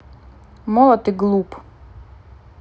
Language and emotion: Russian, angry